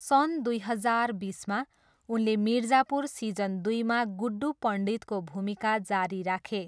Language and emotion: Nepali, neutral